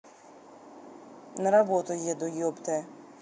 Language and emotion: Russian, angry